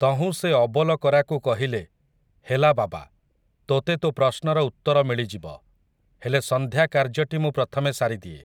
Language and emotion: Odia, neutral